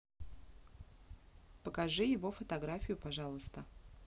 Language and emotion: Russian, neutral